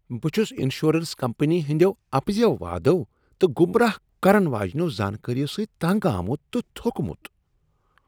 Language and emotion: Kashmiri, disgusted